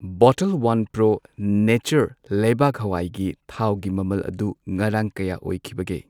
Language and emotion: Manipuri, neutral